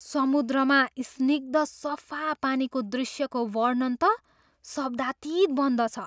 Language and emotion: Nepali, surprised